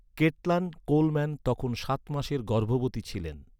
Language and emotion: Bengali, neutral